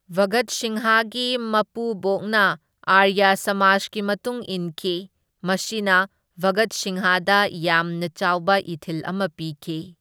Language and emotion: Manipuri, neutral